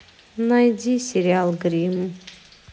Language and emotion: Russian, sad